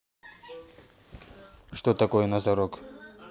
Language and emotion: Russian, neutral